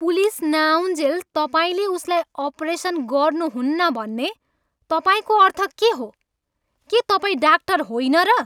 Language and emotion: Nepali, angry